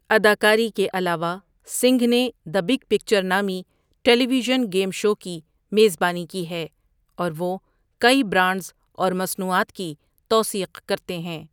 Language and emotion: Urdu, neutral